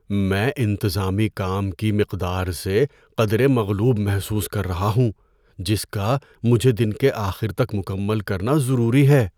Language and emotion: Urdu, fearful